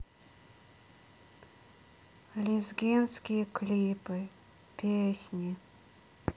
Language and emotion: Russian, sad